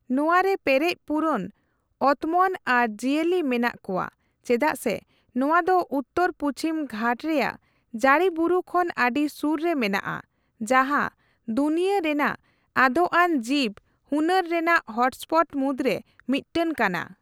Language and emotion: Santali, neutral